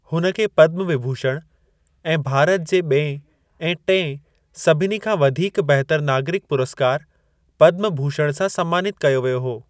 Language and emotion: Sindhi, neutral